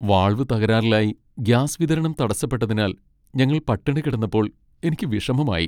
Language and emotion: Malayalam, sad